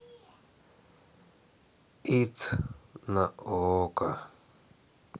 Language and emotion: Russian, sad